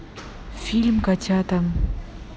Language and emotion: Russian, neutral